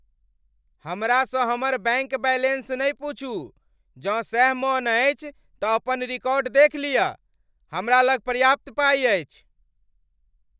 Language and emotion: Maithili, angry